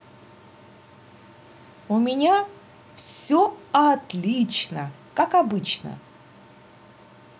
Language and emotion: Russian, positive